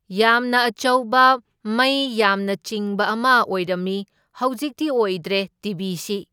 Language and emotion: Manipuri, neutral